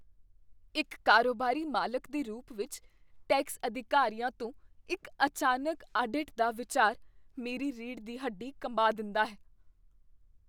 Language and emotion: Punjabi, fearful